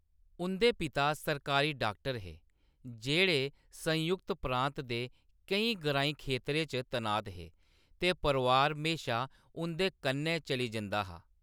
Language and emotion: Dogri, neutral